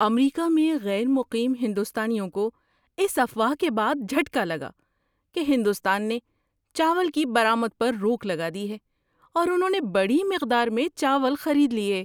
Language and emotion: Urdu, surprised